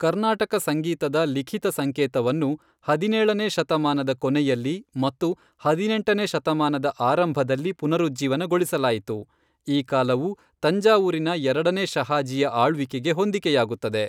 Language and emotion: Kannada, neutral